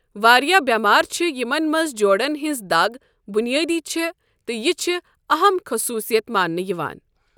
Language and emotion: Kashmiri, neutral